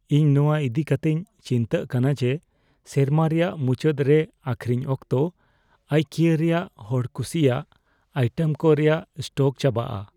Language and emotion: Santali, fearful